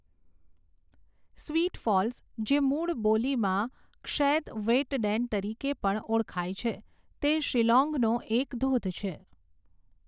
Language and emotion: Gujarati, neutral